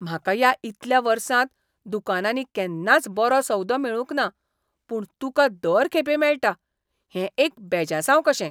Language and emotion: Goan Konkani, disgusted